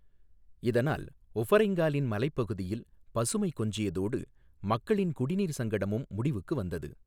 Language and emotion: Tamil, neutral